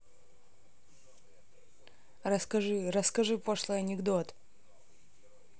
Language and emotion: Russian, neutral